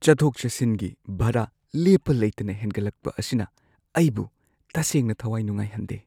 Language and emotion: Manipuri, sad